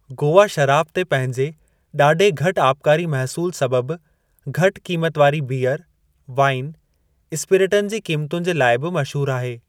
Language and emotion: Sindhi, neutral